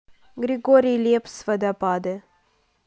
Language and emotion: Russian, neutral